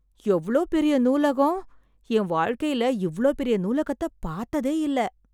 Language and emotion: Tamil, surprised